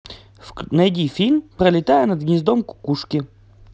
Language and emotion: Russian, positive